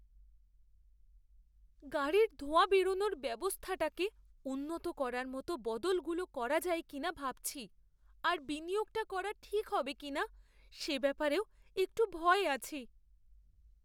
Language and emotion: Bengali, fearful